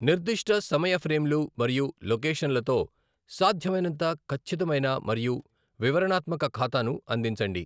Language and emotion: Telugu, neutral